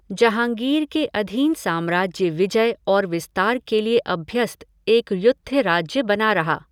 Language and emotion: Hindi, neutral